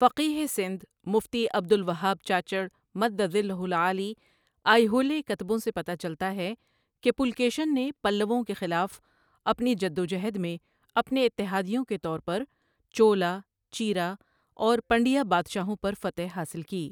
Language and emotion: Urdu, neutral